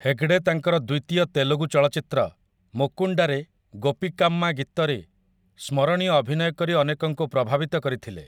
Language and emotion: Odia, neutral